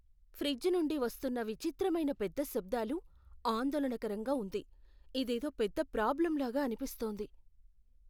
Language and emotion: Telugu, fearful